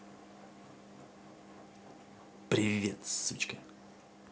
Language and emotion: Russian, angry